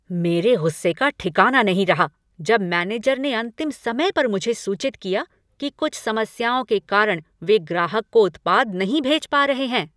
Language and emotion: Hindi, angry